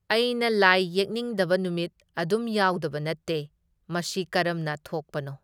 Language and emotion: Manipuri, neutral